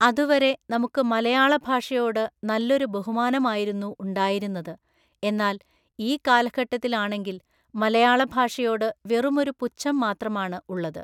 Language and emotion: Malayalam, neutral